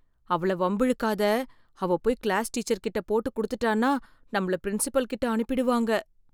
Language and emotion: Tamil, fearful